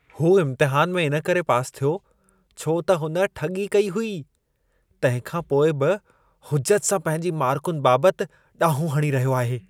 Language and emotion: Sindhi, disgusted